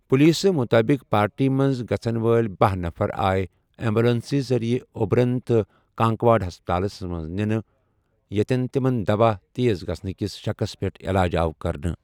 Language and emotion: Kashmiri, neutral